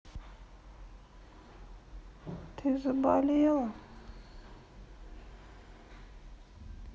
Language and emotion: Russian, sad